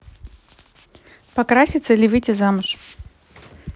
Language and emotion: Russian, neutral